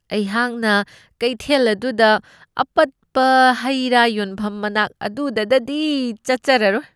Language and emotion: Manipuri, disgusted